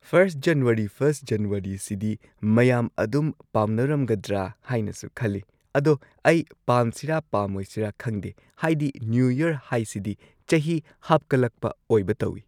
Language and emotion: Manipuri, neutral